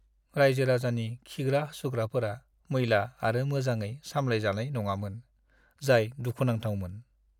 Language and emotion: Bodo, sad